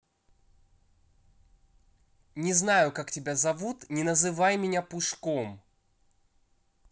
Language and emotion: Russian, angry